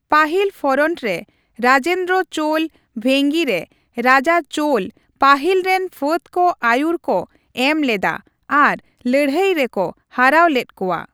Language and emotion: Santali, neutral